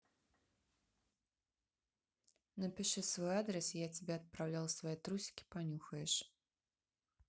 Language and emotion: Russian, neutral